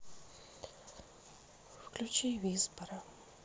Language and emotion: Russian, sad